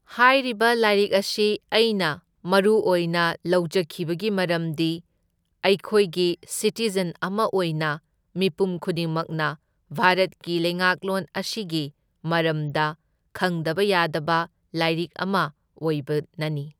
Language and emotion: Manipuri, neutral